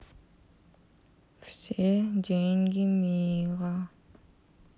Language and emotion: Russian, sad